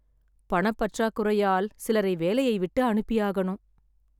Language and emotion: Tamil, sad